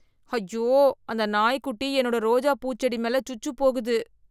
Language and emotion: Tamil, disgusted